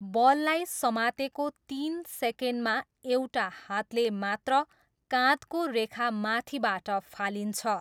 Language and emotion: Nepali, neutral